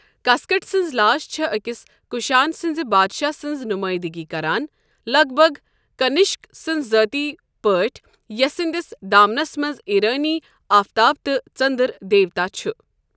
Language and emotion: Kashmiri, neutral